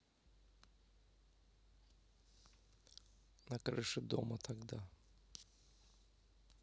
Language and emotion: Russian, neutral